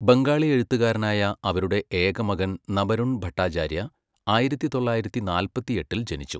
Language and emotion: Malayalam, neutral